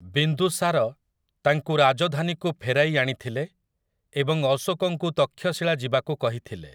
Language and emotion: Odia, neutral